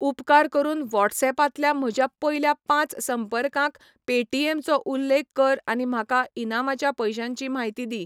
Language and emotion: Goan Konkani, neutral